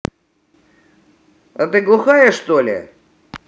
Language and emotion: Russian, angry